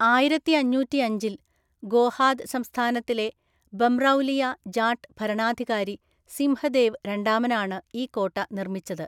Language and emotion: Malayalam, neutral